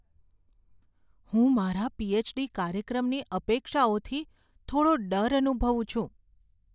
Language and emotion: Gujarati, fearful